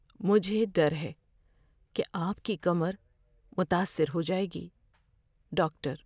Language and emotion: Urdu, fearful